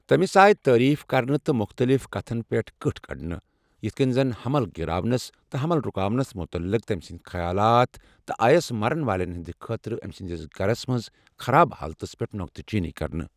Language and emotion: Kashmiri, neutral